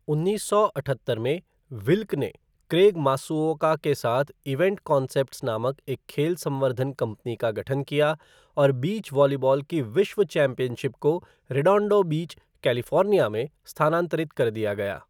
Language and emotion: Hindi, neutral